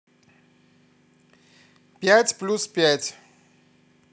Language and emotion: Russian, neutral